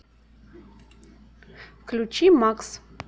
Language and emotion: Russian, neutral